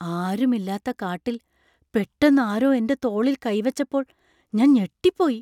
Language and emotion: Malayalam, surprised